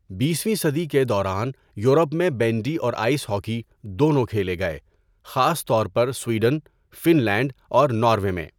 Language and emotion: Urdu, neutral